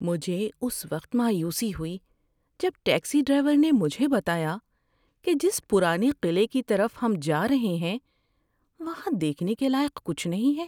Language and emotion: Urdu, sad